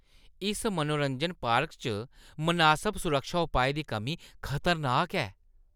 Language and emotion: Dogri, disgusted